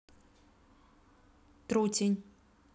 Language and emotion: Russian, neutral